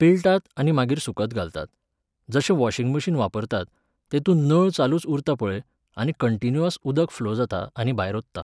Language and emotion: Goan Konkani, neutral